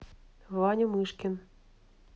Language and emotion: Russian, neutral